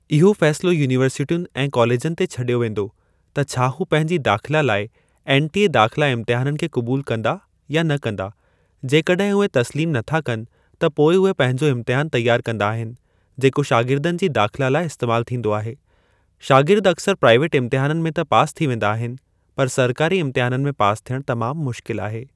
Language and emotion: Sindhi, neutral